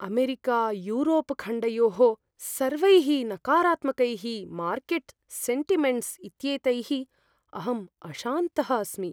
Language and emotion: Sanskrit, fearful